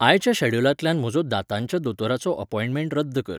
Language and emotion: Goan Konkani, neutral